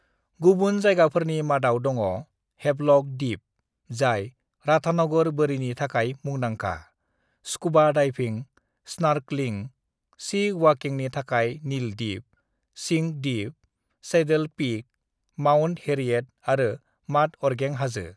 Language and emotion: Bodo, neutral